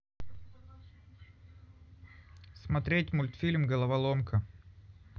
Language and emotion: Russian, neutral